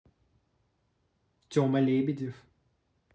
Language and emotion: Russian, neutral